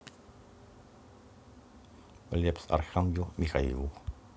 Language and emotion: Russian, neutral